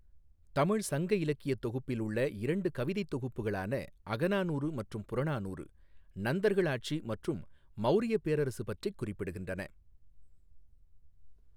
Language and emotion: Tamil, neutral